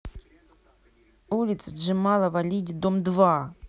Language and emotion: Russian, angry